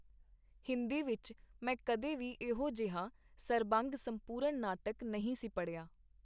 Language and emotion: Punjabi, neutral